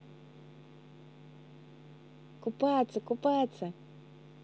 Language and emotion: Russian, positive